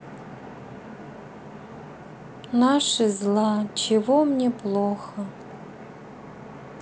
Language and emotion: Russian, sad